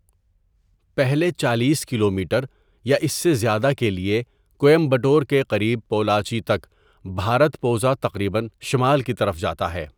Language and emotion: Urdu, neutral